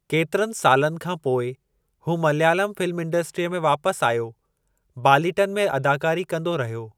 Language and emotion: Sindhi, neutral